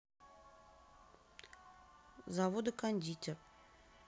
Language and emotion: Russian, neutral